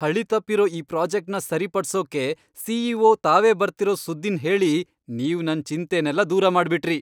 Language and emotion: Kannada, happy